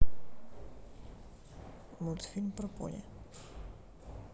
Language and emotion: Russian, neutral